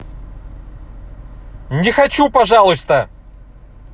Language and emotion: Russian, angry